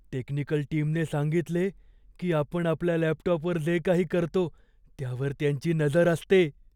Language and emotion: Marathi, fearful